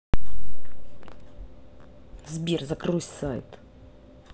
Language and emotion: Russian, angry